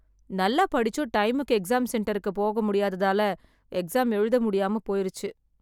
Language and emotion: Tamil, sad